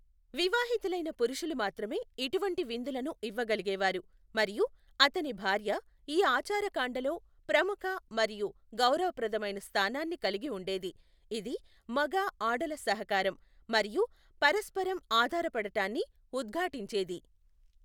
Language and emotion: Telugu, neutral